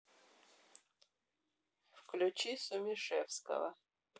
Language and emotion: Russian, neutral